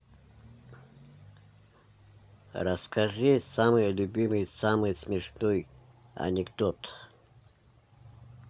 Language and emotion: Russian, neutral